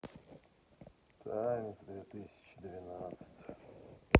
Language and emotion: Russian, sad